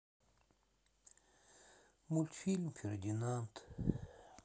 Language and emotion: Russian, sad